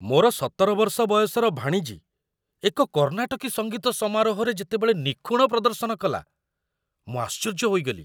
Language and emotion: Odia, surprised